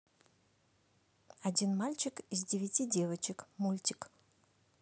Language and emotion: Russian, neutral